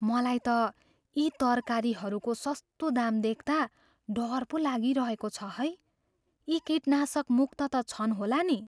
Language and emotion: Nepali, fearful